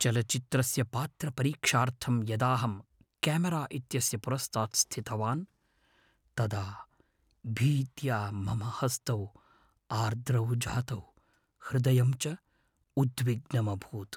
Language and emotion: Sanskrit, fearful